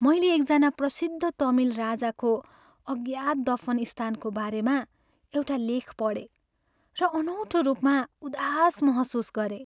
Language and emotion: Nepali, sad